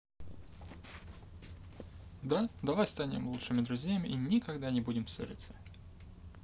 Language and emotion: Russian, neutral